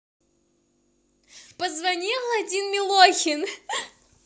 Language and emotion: Russian, positive